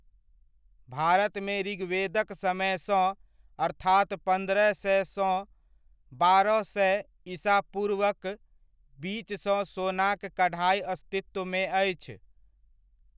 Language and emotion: Maithili, neutral